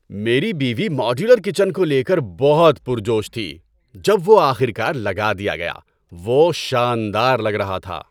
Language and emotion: Urdu, happy